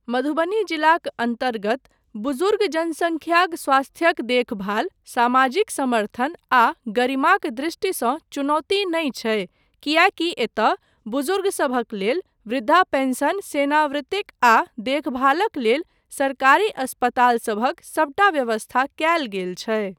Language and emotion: Maithili, neutral